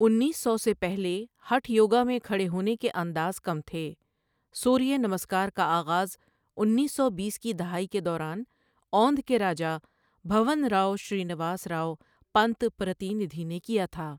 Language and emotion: Urdu, neutral